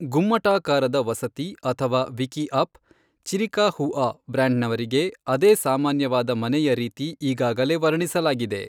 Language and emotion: Kannada, neutral